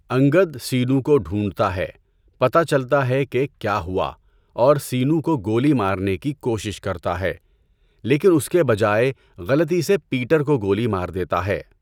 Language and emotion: Urdu, neutral